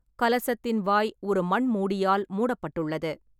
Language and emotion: Tamil, neutral